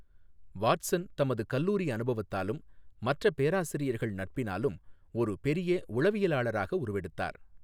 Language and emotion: Tamil, neutral